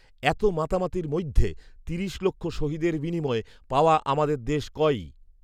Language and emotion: Bengali, neutral